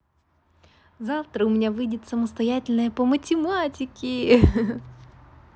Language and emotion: Russian, positive